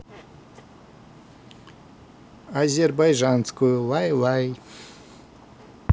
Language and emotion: Russian, neutral